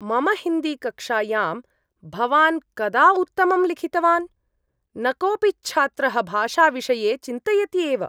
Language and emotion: Sanskrit, disgusted